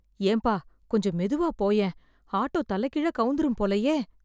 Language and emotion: Tamil, fearful